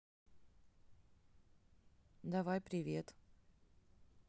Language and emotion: Russian, neutral